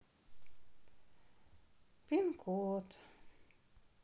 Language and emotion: Russian, sad